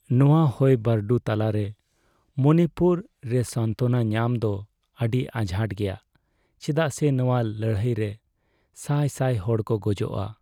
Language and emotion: Santali, sad